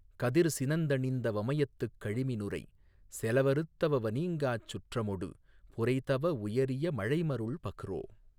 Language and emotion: Tamil, neutral